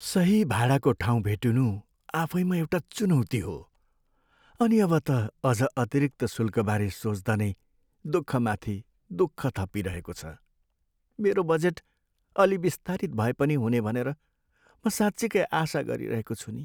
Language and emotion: Nepali, sad